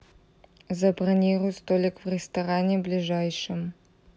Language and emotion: Russian, neutral